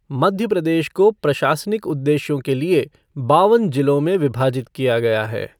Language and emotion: Hindi, neutral